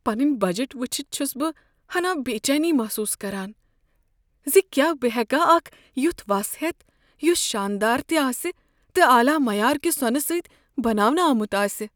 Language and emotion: Kashmiri, fearful